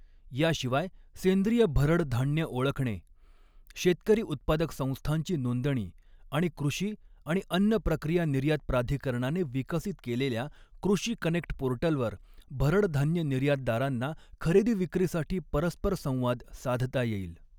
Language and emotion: Marathi, neutral